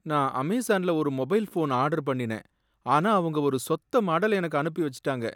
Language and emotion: Tamil, sad